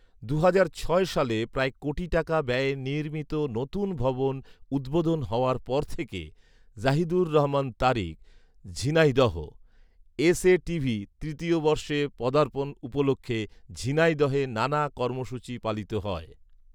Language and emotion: Bengali, neutral